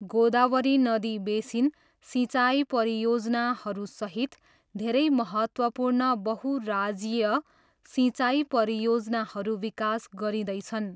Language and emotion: Nepali, neutral